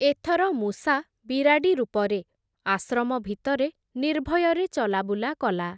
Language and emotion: Odia, neutral